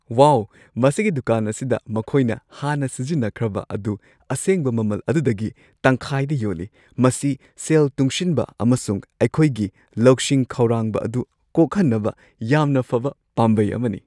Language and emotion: Manipuri, happy